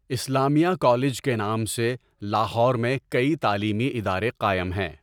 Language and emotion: Urdu, neutral